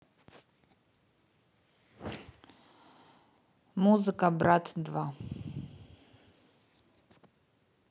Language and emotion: Russian, neutral